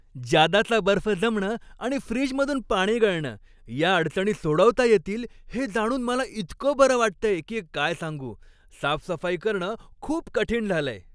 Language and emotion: Marathi, happy